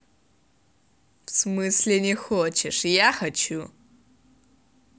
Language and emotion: Russian, angry